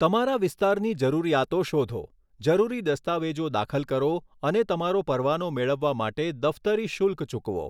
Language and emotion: Gujarati, neutral